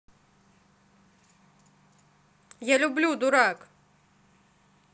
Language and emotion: Russian, neutral